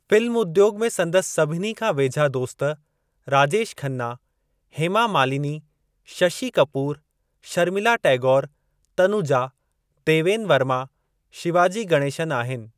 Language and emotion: Sindhi, neutral